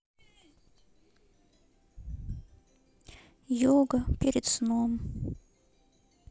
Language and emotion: Russian, sad